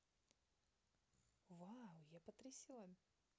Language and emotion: Russian, positive